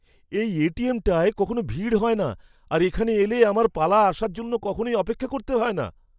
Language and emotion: Bengali, surprised